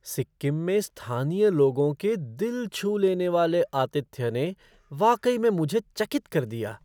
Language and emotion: Hindi, surprised